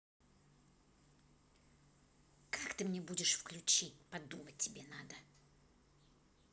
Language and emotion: Russian, angry